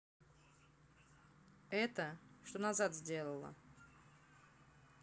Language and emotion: Russian, neutral